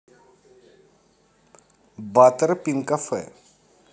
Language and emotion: Russian, positive